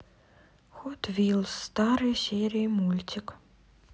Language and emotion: Russian, sad